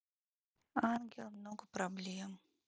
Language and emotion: Russian, sad